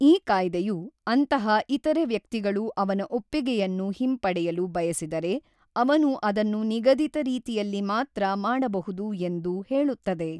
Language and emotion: Kannada, neutral